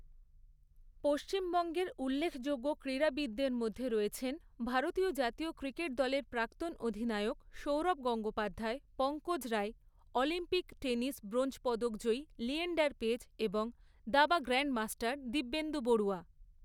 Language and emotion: Bengali, neutral